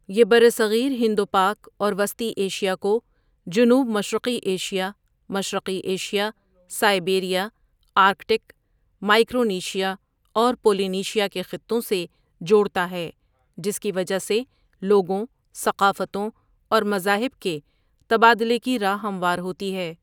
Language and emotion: Urdu, neutral